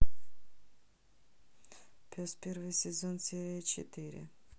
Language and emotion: Russian, neutral